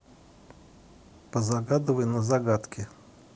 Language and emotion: Russian, neutral